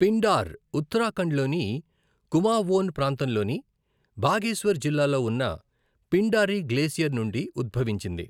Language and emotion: Telugu, neutral